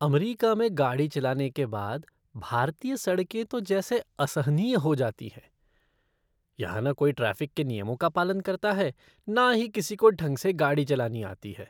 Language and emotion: Hindi, disgusted